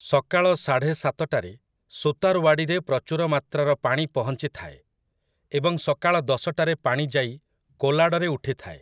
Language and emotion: Odia, neutral